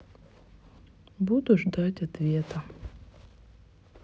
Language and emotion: Russian, sad